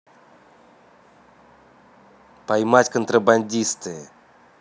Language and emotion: Russian, neutral